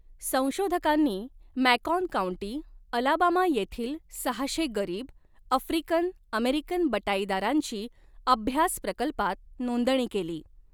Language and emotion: Marathi, neutral